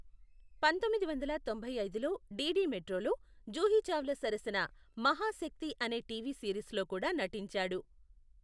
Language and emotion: Telugu, neutral